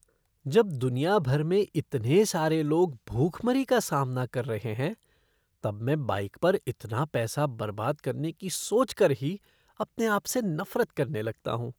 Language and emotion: Hindi, disgusted